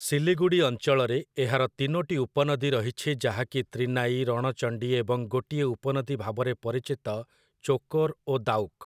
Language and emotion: Odia, neutral